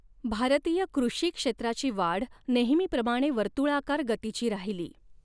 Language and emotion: Marathi, neutral